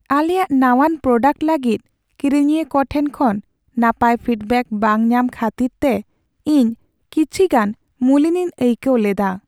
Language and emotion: Santali, sad